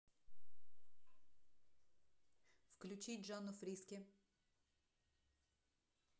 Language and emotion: Russian, neutral